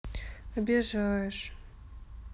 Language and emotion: Russian, sad